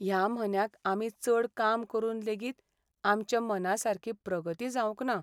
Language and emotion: Goan Konkani, sad